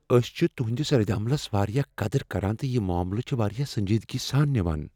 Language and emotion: Kashmiri, fearful